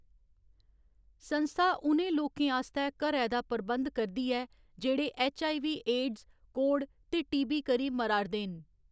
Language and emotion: Dogri, neutral